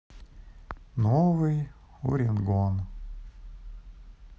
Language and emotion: Russian, sad